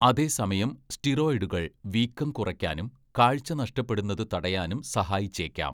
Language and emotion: Malayalam, neutral